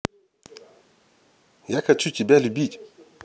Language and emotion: Russian, positive